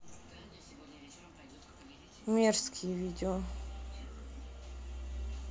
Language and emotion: Russian, neutral